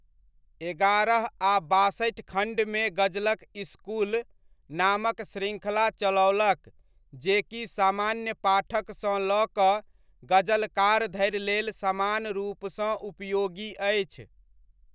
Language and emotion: Maithili, neutral